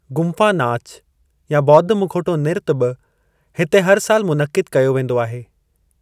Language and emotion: Sindhi, neutral